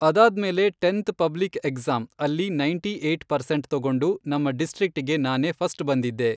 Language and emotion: Kannada, neutral